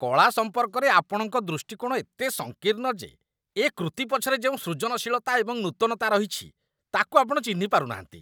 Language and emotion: Odia, disgusted